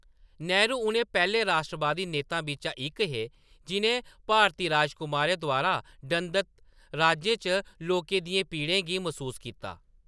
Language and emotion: Dogri, neutral